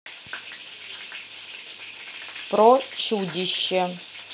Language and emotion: Russian, neutral